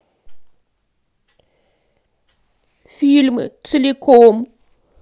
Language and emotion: Russian, sad